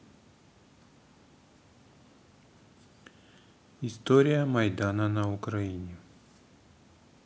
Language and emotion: Russian, neutral